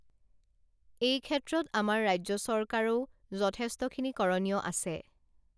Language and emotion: Assamese, neutral